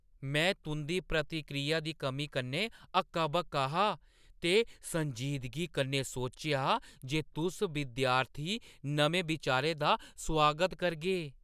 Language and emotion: Dogri, surprised